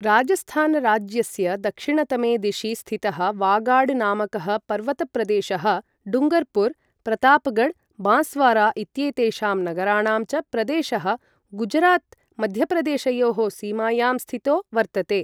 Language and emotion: Sanskrit, neutral